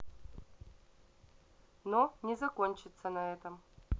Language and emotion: Russian, neutral